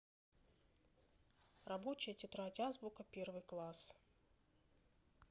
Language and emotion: Russian, neutral